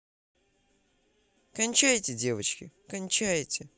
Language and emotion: Russian, positive